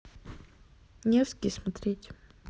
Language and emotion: Russian, neutral